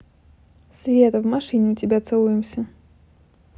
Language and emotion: Russian, neutral